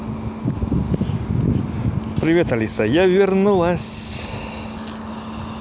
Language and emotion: Russian, positive